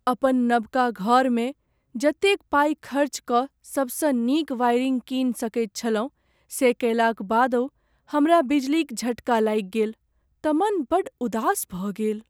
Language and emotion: Maithili, sad